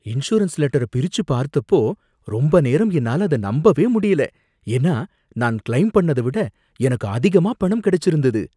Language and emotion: Tamil, surprised